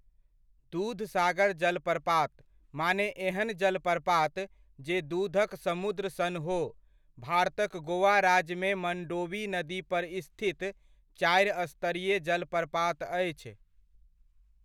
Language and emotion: Maithili, neutral